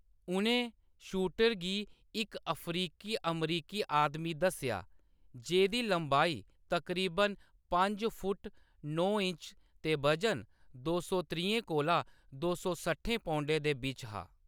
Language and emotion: Dogri, neutral